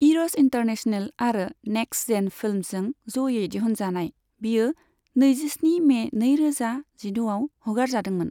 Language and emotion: Bodo, neutral